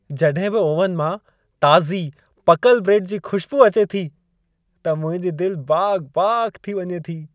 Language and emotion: Sindhi, happy